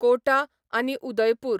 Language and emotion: Goan Konkani, neutral